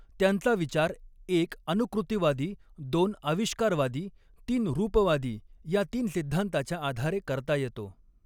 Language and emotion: Marathi, neutral